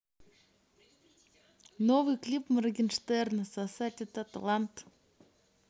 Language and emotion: Russian, neutral